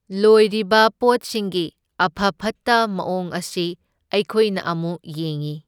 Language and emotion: Manipuri, neutral